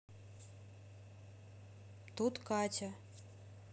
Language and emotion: Russian, neutral